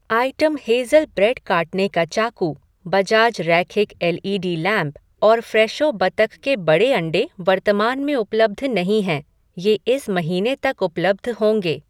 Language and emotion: Hindi, neutral